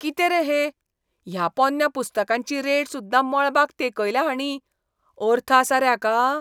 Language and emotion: Goan Konkani, disgusted